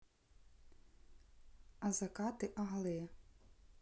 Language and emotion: Russian, neutral